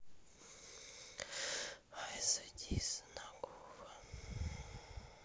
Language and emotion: Russian, sad